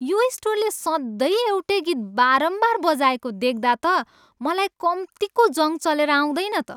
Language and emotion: Nepali, disgusted